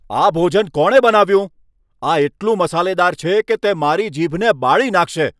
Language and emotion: Gujarati, angry